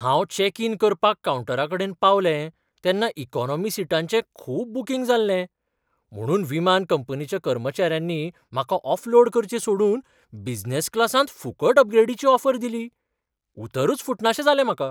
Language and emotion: Goan Konkani, surprised